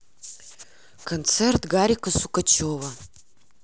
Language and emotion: Russian, neutral